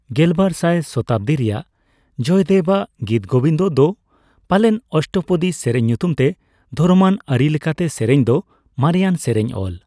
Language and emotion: Santali, neutral